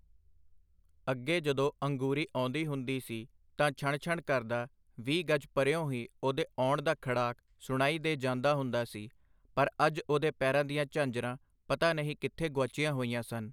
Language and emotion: Punjabi, neutral